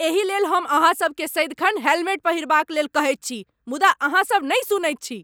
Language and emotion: Maithili, angry